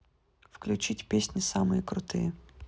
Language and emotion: Russian, neutral